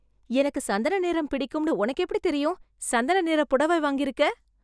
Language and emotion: Tamil, surprised